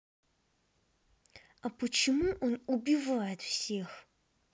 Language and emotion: Russian, angry